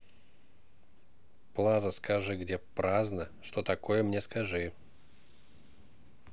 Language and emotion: Russian, neutral